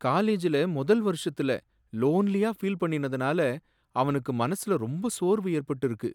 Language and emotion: Tamil, sad